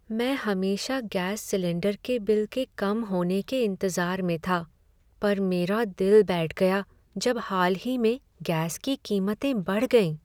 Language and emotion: Hindi, sad